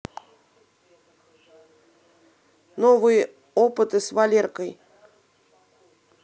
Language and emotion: Russian, neutral